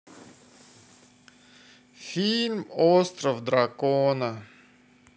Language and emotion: Russian, sad